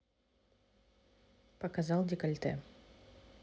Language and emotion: Russian, neutral